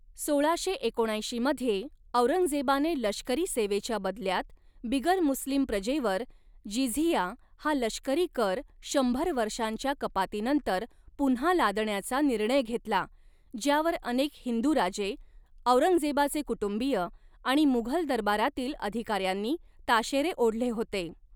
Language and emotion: Marathi, neutral